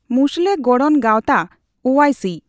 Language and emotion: Santali, neutral